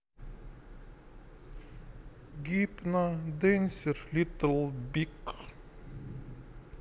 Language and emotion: Russian, neutral